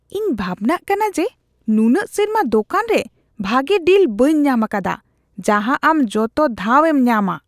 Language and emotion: Santali, disgusted